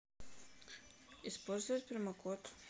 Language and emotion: Russian, neutral